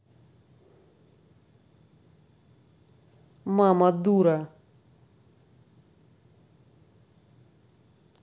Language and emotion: Russian, angry